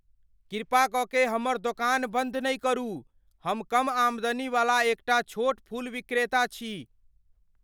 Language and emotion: Maithili, fearful